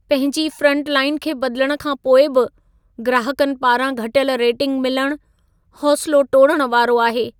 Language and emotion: Sindhi, sad